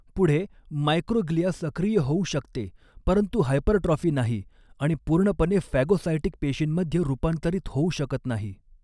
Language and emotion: Marathi, neutral